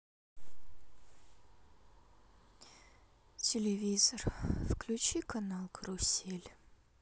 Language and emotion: Russian, sad